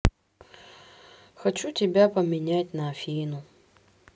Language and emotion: Russian, sad